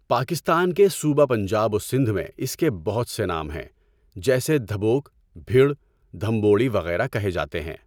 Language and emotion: Urdu, neutral